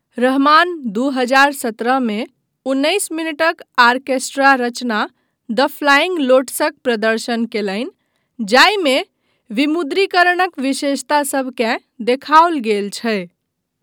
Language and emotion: Maithili, neutral